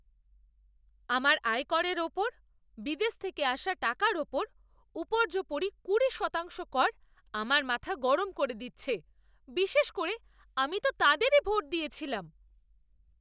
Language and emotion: Bengali, angry